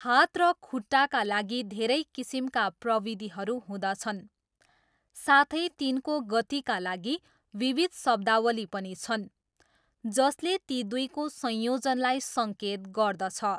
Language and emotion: Nepali, neutral